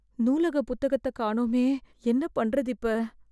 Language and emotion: Tamil, fearful